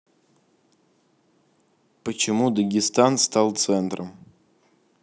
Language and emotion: Russian, neutral